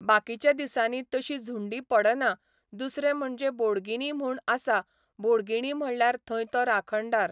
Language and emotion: Goan Konkani, neutral